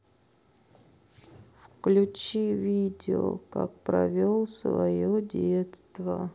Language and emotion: Russian, sad